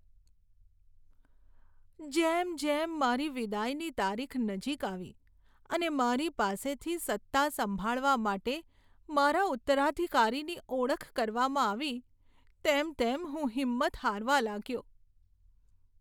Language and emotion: Gujarati, sad